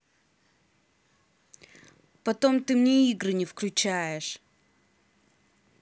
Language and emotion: Russian, angry